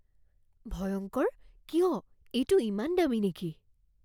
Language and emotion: Assamese, fearful